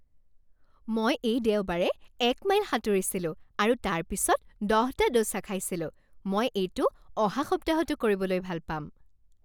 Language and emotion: Assamese, happy